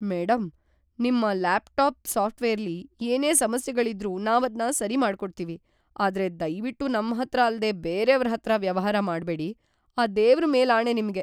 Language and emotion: Kannada, fearful